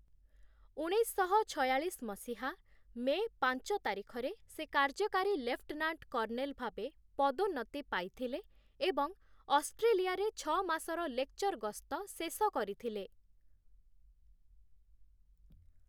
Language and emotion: Odia, neutral